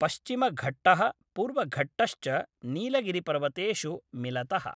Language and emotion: Sanskrit, neutral